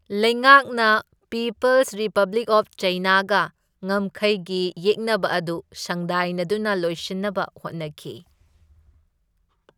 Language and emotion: Manipuri, neutral